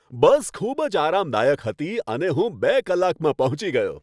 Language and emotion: Gujarati, happy